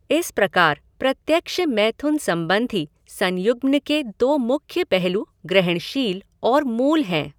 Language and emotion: Hindi, neutral